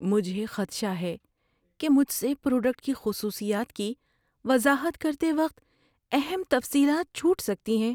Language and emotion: Urdu, fearful